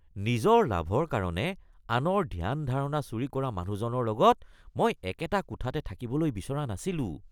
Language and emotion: Assamese, disgusted